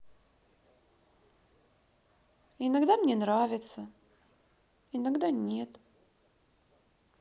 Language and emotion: Russian, sad